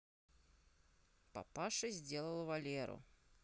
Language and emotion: Russian, neutral